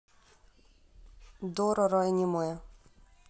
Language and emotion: Russian, neutral